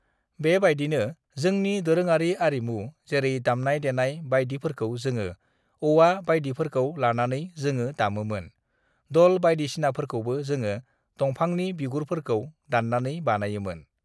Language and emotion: Bodo, neutral